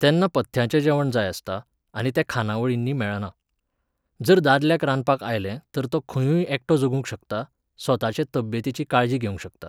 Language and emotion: Goan Konkani, neutral